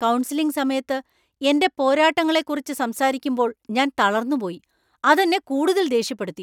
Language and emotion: Malayalam, angry